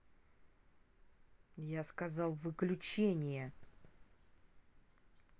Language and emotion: Russian, angry